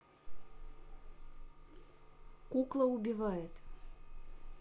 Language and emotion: Russian, neutral